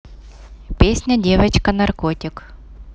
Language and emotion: Russian, neutral